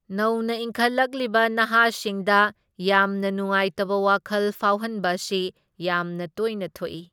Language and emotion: Manipuri, neutral